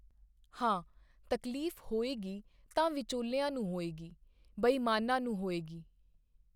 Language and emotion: Punjabi, neutral